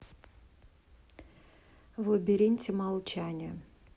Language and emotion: Russian, neutral